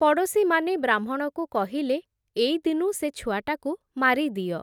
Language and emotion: Odia, neutral